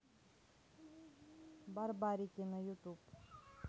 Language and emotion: Russian, neutral